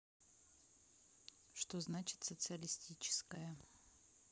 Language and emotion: Russian, neutral